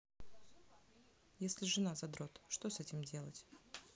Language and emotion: Russian, neutral